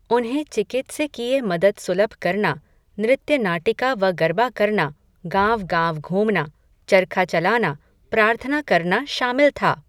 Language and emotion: Hindi, neutral